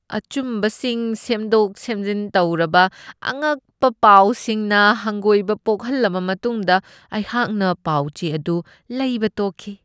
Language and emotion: Manipuri, disgusted